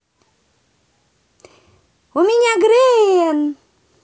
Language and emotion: Russian, positive